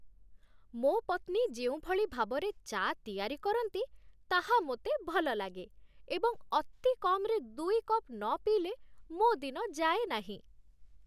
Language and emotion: Odia, happy